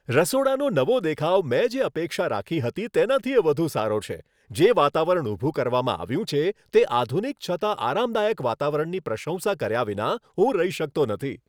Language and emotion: Gujarati, happy